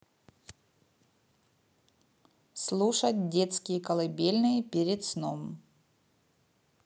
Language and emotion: Russian, neutral